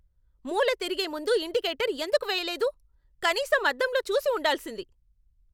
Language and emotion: Telugu, angry